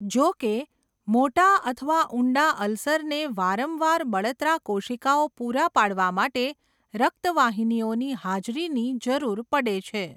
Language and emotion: Gujarati, neutral